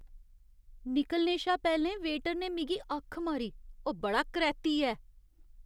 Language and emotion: Dogri, disgusted